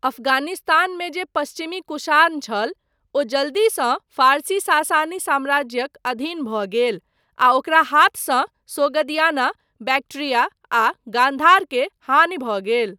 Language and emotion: Maithili, neutral